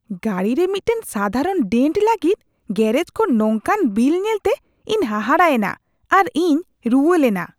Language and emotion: Santali, disgusted